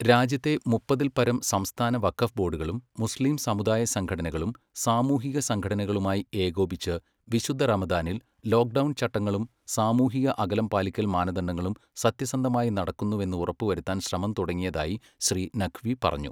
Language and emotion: Malayalam, neutral